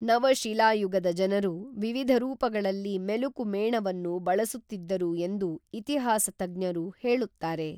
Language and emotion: Kannada, neutral